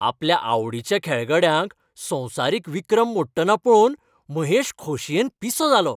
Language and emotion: Goan Konkani, happy